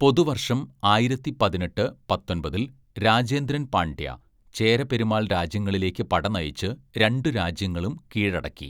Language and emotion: Malayalam, neutral